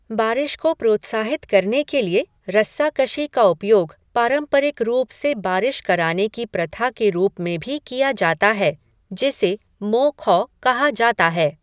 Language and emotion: Hindi, neutral